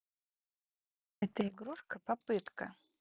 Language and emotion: Russian, neutral